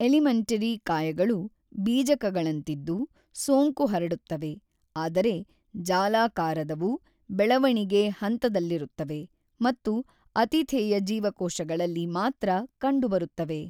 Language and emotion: Kannada, neutral